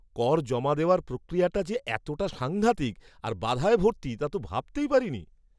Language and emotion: Bengali, surprised